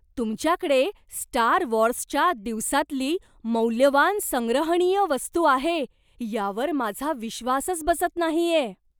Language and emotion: Marathi, surprised